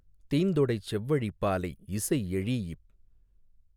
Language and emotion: Tamil, neutral